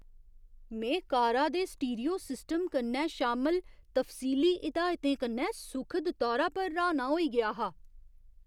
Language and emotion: Dogri, surprised